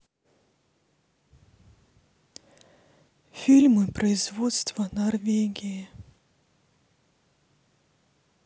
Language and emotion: Russian, sad